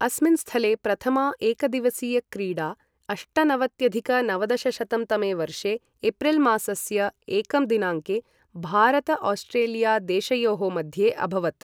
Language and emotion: Sanskrit, neutral